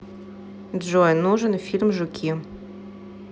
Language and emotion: Russian, neutral